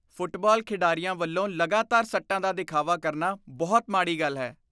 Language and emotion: Punjabi, disgusted